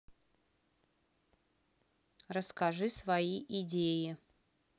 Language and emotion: Russian, neutral